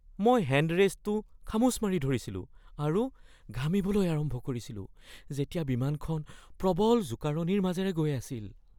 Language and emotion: Assamese, fearful